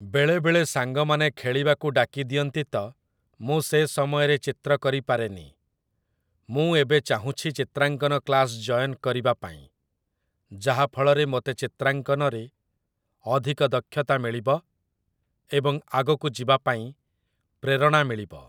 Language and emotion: Odia, neutral